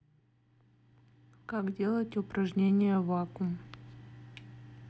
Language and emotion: Russian, neutral